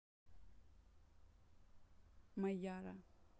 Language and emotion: Russian, neutral